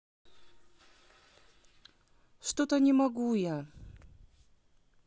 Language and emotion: Russian, sad